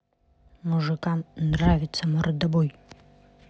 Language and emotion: Russian, neutral